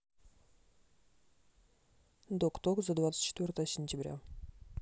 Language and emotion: Russian, neutral